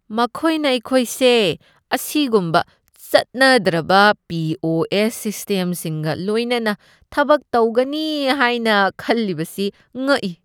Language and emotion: Manipuri, disgusted